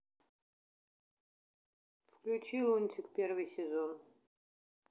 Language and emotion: Russian, neutral